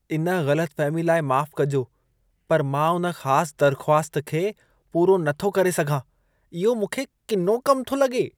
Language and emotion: Sindhi, disgusted